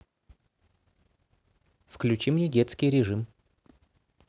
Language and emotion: Russian, neutral